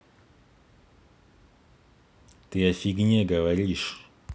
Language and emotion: Russian, angry